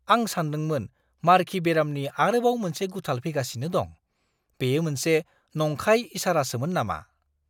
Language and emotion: Bodo, surprised